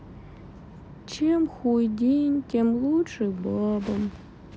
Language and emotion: Russian, sad